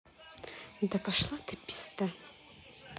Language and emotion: Russian, angry